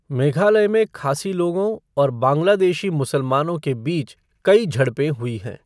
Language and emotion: Hindi, neutral